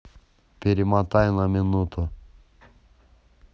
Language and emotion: Russian, neutral